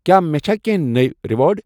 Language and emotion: Kashmiri, neutral